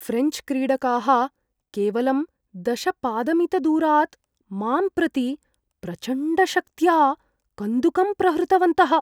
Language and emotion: Sanskrit, fearful